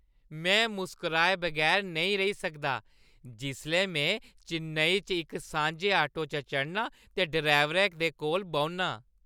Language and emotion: Dogri, happy